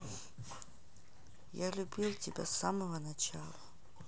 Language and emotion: Russian, sad